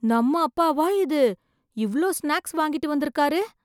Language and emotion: Tamil, surprised